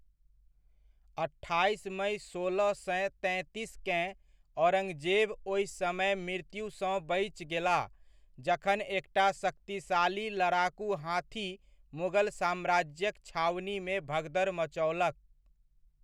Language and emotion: Maithili, neutral